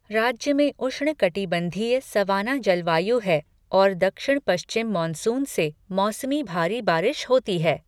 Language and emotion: Hindi, neutral